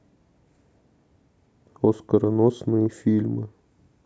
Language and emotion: Russian, neutral